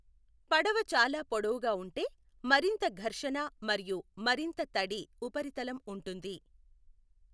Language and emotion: Telugu, neutral